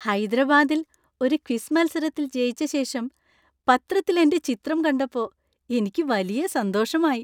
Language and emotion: Malayalam, happy